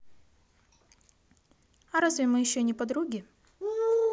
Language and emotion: Russian, positive